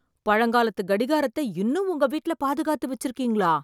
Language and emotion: Tamil, surprised